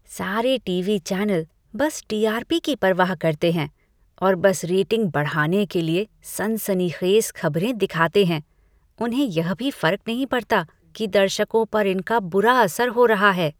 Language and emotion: Hindi, disgusted